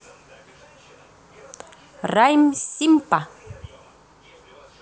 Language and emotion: Russian, positive